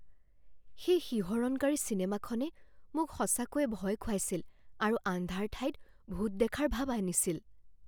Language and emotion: Assamese, fearful